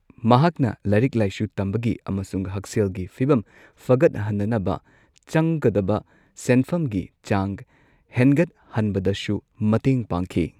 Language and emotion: Manipuri, neutral